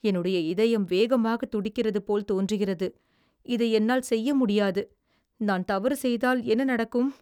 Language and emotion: Tamil, fearful